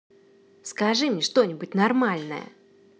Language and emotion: Russian, angry